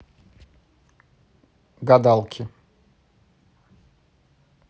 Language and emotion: Russian, neutral